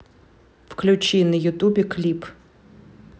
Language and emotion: Russian, neutral